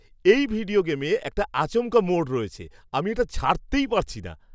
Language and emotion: Bengali, surprised